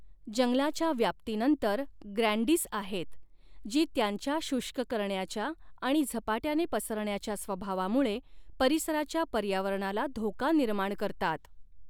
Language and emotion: Marathi, neutral